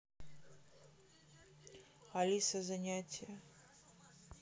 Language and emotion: Russian, neutral